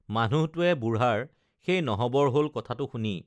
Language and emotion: Assamese, neutral